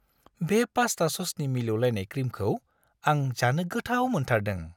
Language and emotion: Bodo, happy